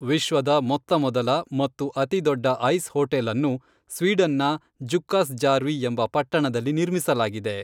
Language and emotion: Kannada, neutral